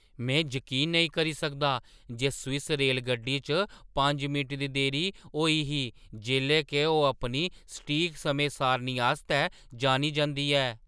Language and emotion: Dogri, surprised